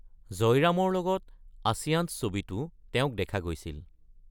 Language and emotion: Assamese, neutral